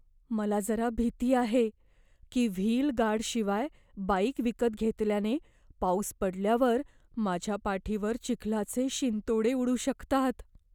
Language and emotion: Marathi, fearful